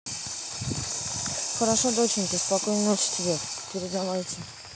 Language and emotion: Russian, neutral